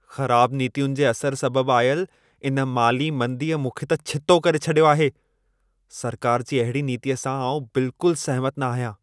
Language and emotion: Sindhi, angry